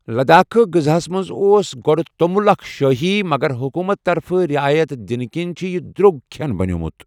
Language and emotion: Kashmiri, neutral